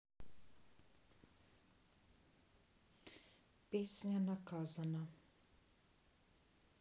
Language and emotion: Russian, sad